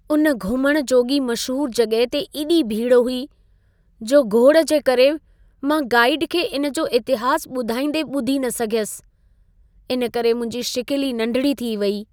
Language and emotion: Sindhi, sad